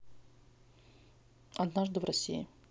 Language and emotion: Russian, neutral